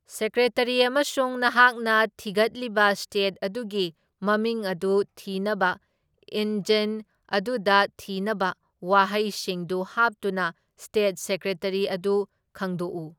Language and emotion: Manipuri, neutral